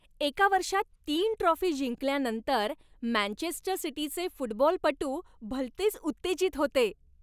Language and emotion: Marathi, happy